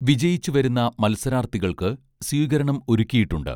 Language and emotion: Malayalam, neutral